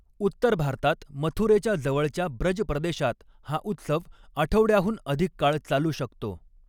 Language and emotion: Marathi, neutral